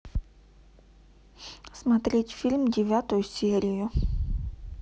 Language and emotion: Russian, neutral